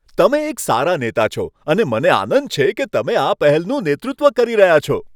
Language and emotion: Gujarati, happy